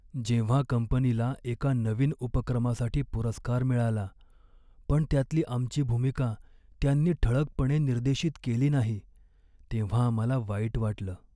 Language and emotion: Marathi, sad